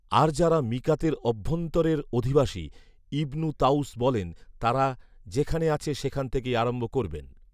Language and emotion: Bengali, neutral